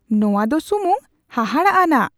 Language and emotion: Santali, surprised